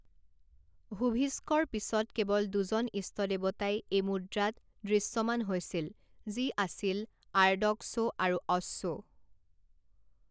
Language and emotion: Assamese, neutral